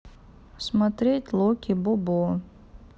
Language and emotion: Russian, neutral